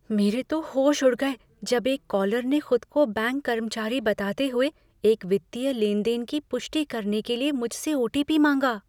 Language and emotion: Hindi, fearful